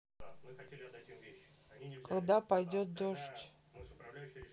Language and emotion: Russian, neutral